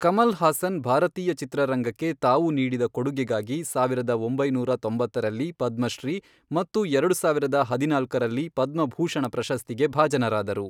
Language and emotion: Kannada, neutral